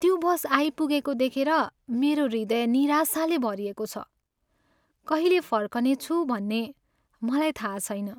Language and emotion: Nepali, sad